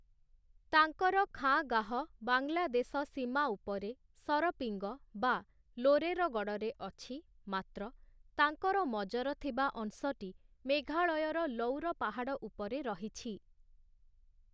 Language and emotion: Odia, neutral